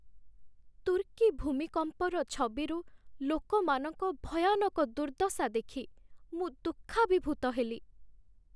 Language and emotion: Odia, sad